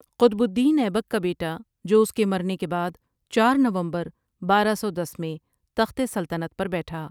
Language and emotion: Urdu, neutral